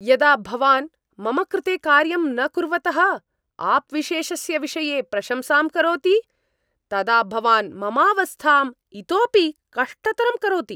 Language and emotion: Sanskrit, angry